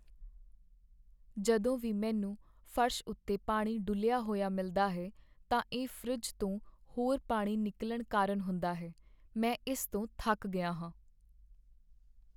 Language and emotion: Punjabi, sad